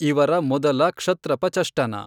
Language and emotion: Kannada, neutral